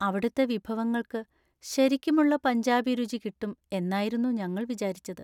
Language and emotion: Malayalam, sad